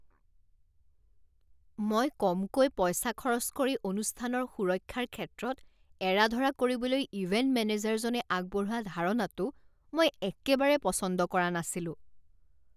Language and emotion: Assamese, disgusted